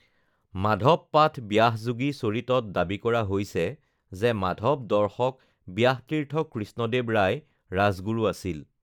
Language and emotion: Assamese, neutral